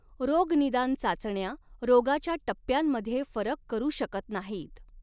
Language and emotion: Marathi, neutral